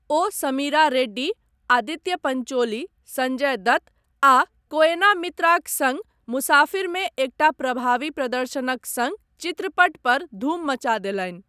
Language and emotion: Maithili, neutral